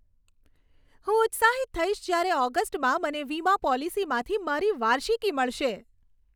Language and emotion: Gujarati, happy